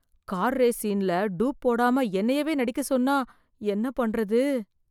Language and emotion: Tamil, fearful